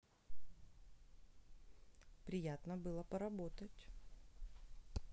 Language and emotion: Russian, neutral